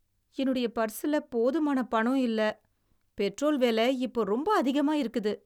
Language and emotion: Tamil, sad